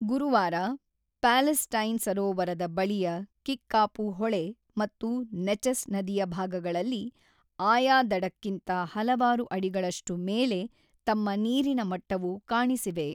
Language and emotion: Kannada, neutral